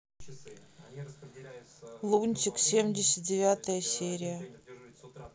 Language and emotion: Russian, sad